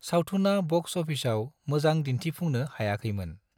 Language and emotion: Bodo, neutral